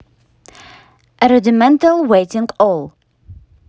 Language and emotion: Russian, neutral